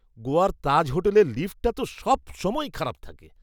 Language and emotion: Bengali, disgusted